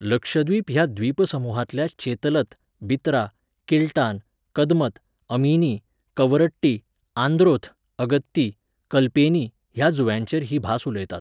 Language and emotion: Goan Konkani, neutral